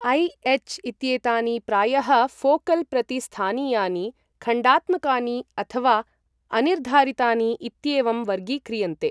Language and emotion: Sanskrit, neutral